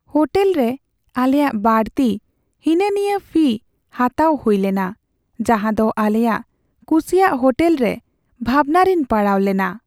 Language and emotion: Santali, sad